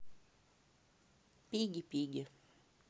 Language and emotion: Russian, neutral